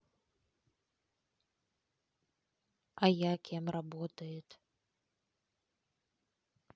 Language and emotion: Russian, neutral